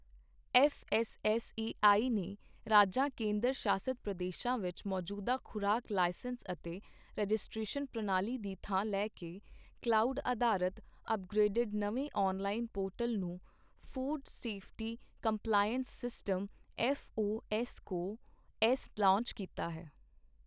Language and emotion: Punjabi, neutral